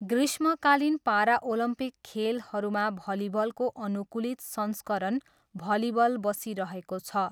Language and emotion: Nepali, neutral